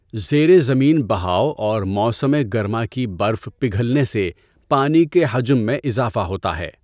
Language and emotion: Urdu, neutral